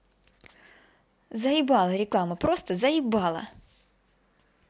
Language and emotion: Russian, angry